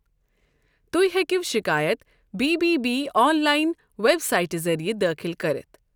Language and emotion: Kashmiri, neutral